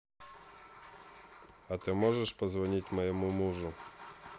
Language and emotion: Russian, neutral